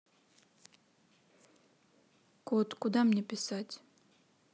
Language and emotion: Russian, neutral